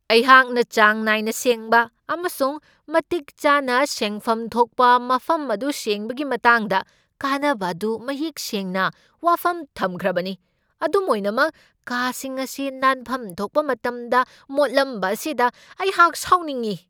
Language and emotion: Manipuri, angry